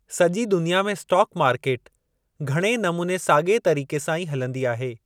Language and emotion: Sindhi, neutral